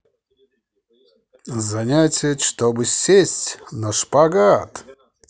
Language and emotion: Russian, positive